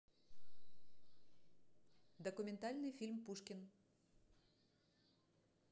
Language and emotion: Russian, neutral